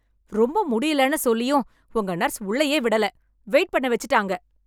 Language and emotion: Tamil, angry